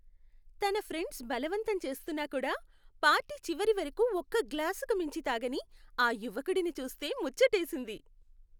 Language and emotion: Telugu, happy